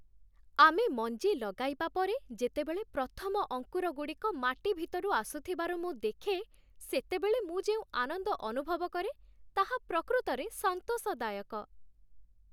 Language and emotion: Odia, happy